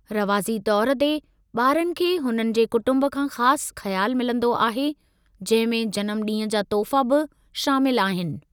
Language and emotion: Sindhi, neutral